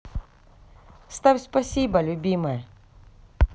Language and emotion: Russian, positive